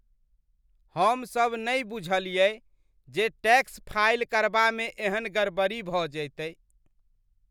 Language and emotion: Maithili, disgusted